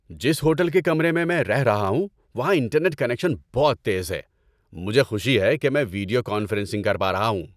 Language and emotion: Urdu, happy